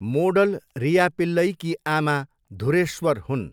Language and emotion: Nepali, neutral